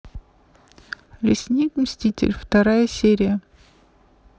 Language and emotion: Russian, neutral